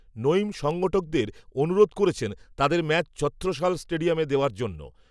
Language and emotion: Bengali, neutral